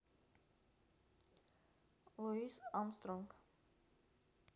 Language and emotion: Russian, neutral